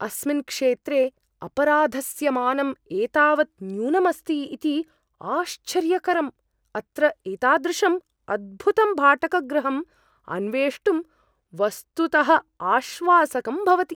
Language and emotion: Sanskrit, surprised